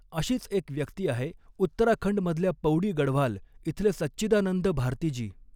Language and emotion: Marathi, neutral